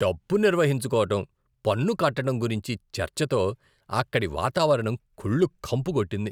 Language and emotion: Telugu, disgusted